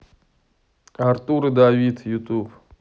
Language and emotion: Russian, neutral